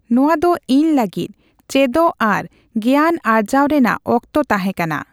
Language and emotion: Santali, neutral